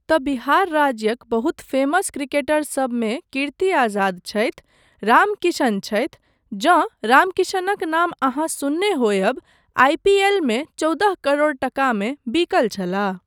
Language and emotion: Maithili, neutral